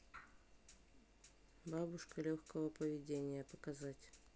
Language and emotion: Russian, neutral